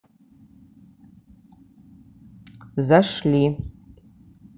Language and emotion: Russian, neutral